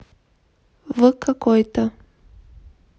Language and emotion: Russian, neutral